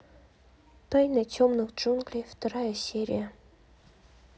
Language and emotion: Russian, neutral